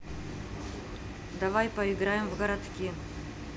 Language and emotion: Russian, neutral